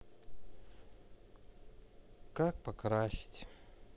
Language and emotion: Russian, sad